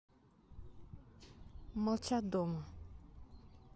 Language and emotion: Russian, neutral